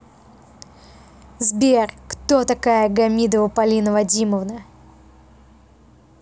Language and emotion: Russian, angry